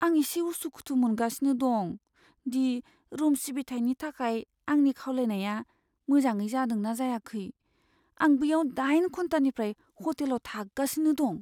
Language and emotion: Bodo, fearful